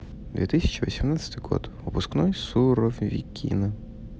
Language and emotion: Russian, neutral